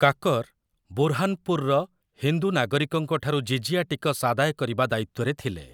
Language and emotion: Odia, neutral